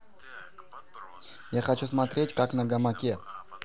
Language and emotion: Russian, neutral